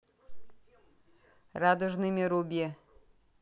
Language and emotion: Russian, neutral